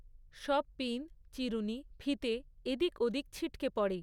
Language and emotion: Bengali, neutral